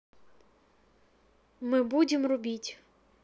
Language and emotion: Russian, neutral